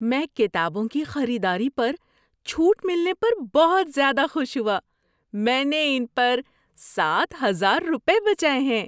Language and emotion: Urdu, happy